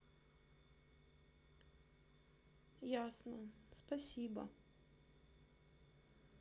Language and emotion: Russian, sad